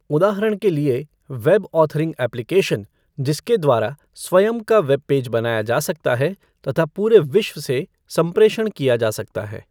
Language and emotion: Hindi, neutral